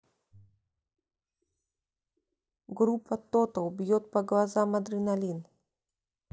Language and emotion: Russian, neutral